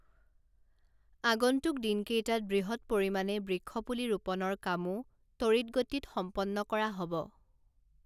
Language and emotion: Assamese, neutral